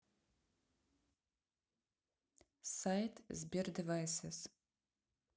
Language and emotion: Russian, neutral